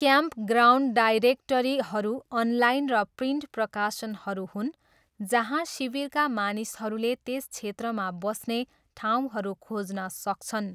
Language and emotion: Nepali, neutral